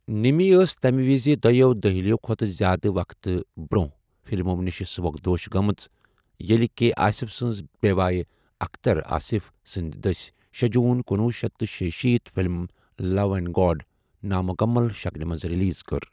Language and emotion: Kashmiri, neutral